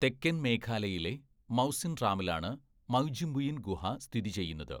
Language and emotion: Malayalam, neutral